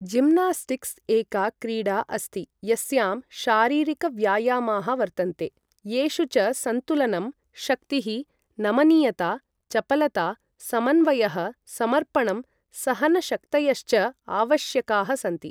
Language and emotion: Sanskrit, neutral